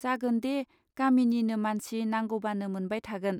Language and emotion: Bodo, neutral